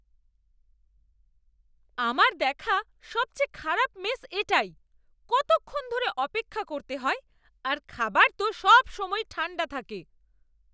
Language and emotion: Bengali, angry